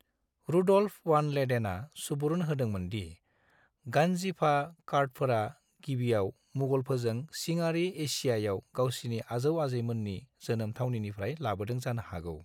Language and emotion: Bodo, neutral